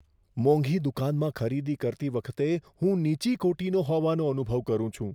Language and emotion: Gujarati, fearful